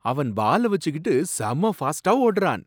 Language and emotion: Tamil, surprised